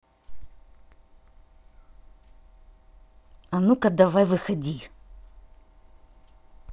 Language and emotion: Russian, angry